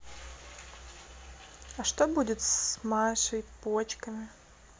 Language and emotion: Russian, sad